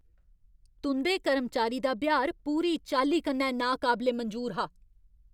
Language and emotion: Dogri, angry